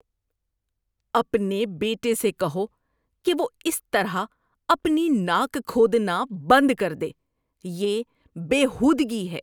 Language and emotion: Urdu, disgusted